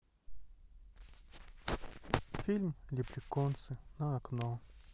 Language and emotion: Russian, sad